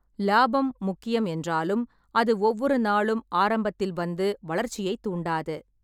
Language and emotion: Tamil, neutral